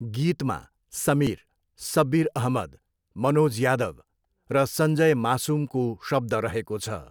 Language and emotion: Nepali, neutral